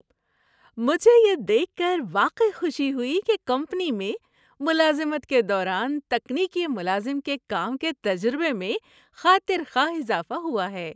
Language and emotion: Urdu, happy